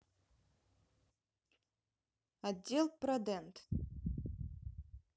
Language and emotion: Russian, neutral